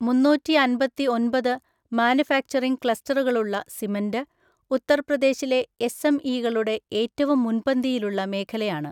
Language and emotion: Malayalam, neutral